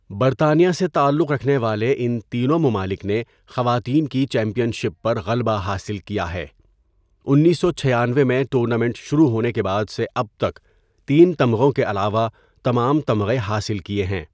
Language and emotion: Urdu, neutral